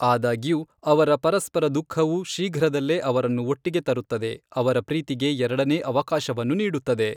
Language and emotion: Kannada, neutral